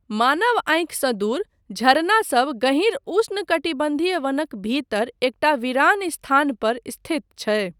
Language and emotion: Maithili, neutral